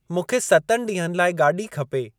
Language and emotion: Sindhi, neutral